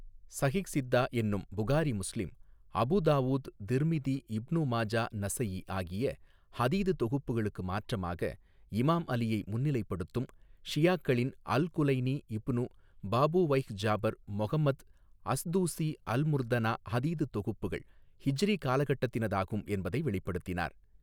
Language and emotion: Tamil, neutral